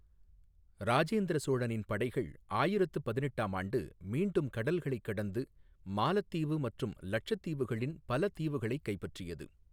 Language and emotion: Tamil, neutral